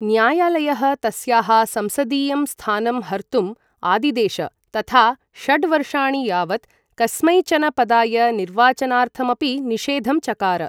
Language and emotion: Sanskrit, neutral